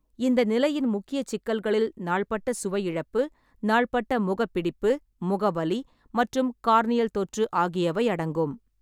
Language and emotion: Tamil, neutral